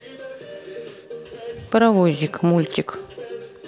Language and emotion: Russian, neutral